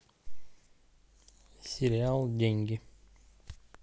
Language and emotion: Russian, neutral